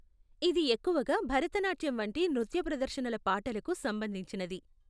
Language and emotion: Telugu, neutral